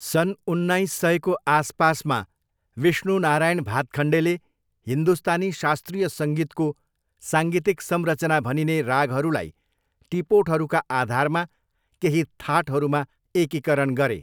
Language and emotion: Nepali, neutral